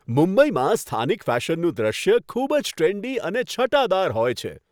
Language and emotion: Gujarati, happy